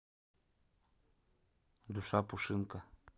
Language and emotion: Russian, neutral